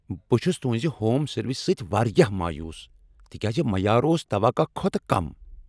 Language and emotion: Kashmiri, angry